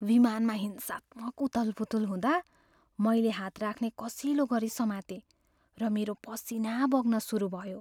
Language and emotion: Nepali, fearful